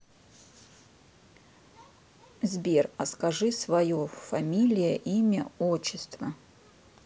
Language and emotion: Russian, neutral